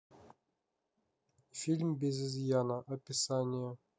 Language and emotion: Russian, neutral